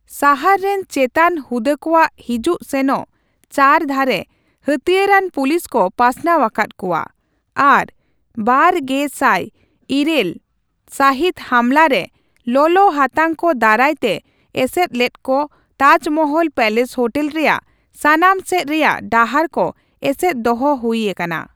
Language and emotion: Santali, neutral